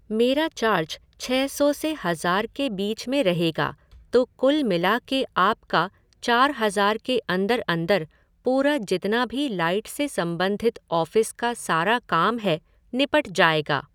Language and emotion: Hindi, neutral